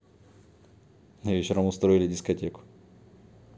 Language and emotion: Russian, neutral